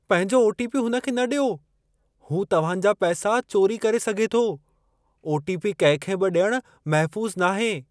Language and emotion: Sindhi, fearful